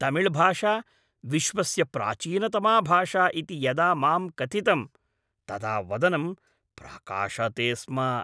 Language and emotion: Sanskrit, happy